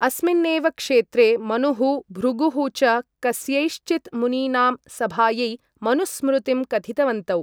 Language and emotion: Sanskrit, neutral